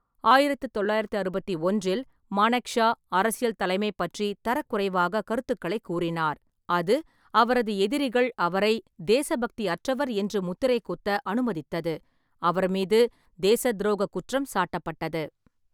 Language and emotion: Tamil, neutral